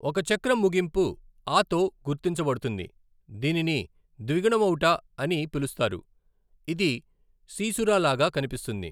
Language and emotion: Telugu, neutral